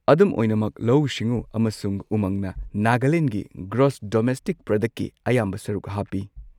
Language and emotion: Manipuri, neutral